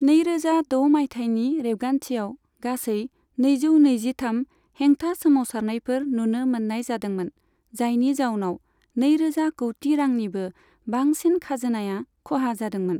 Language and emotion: Bodo, neutral